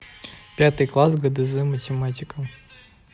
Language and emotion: Russian, neutral